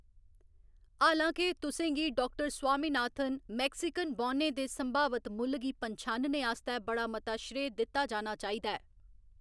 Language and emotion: Dogri, neutral